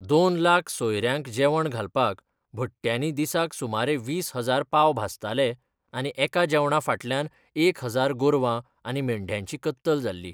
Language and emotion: Goan Konkani, neutral